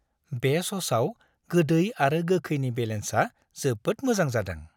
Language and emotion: Bodo, happy